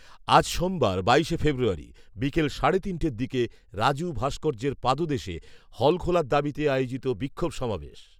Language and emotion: Bengali, neutral